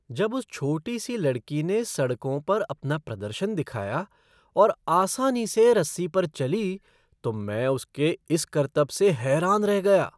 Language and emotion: Hindi, surprised